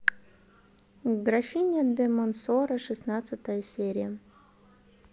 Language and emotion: Russian, neutral